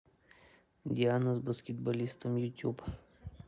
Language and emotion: Russian, neutral